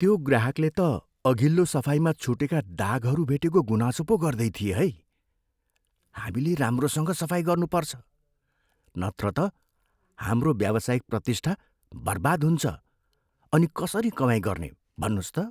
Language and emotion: Nepali, fearful